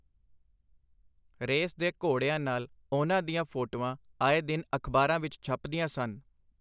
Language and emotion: Punjabi, neutral